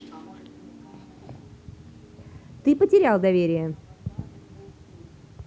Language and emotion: Russian, neutral